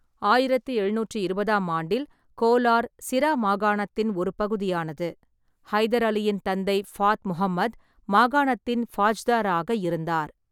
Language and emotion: Tamil, neutral